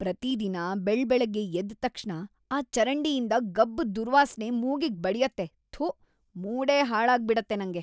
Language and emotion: Kannada, disgusted